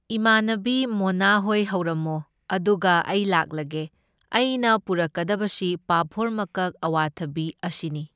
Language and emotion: Manipuri, neutral